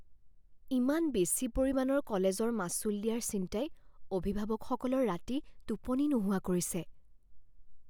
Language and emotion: Assamese, fearful